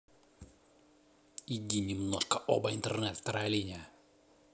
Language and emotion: Russian, neutral